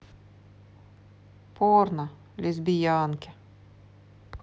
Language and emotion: Russian, sad